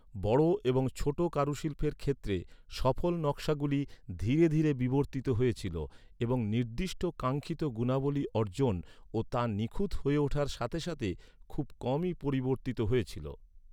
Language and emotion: Bengali, neutral